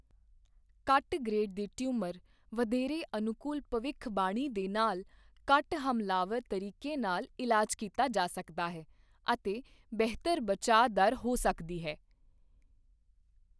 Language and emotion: Punjabi, neutral